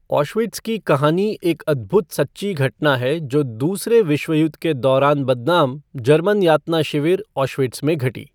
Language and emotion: Hindi, neutral